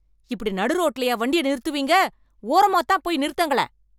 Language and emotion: Tamil, angry